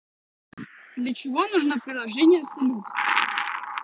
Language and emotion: Russian, neutral